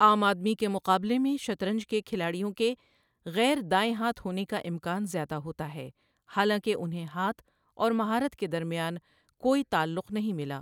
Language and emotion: Urdu, neutral